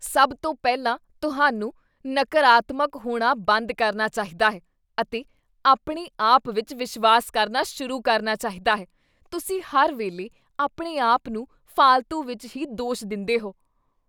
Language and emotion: Punjabi, disgusted